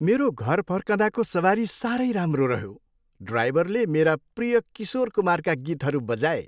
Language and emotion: Nepali, happy